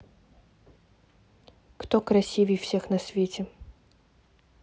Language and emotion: Russian, neutral